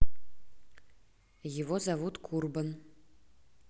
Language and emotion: Russian, neutral